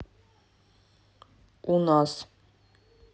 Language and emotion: Russian, neutral